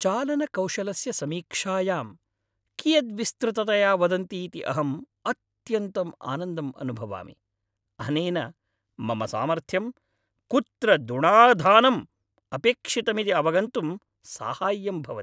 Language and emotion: Sanskrit, happy